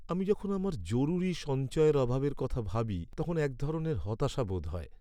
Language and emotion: Bengali, sad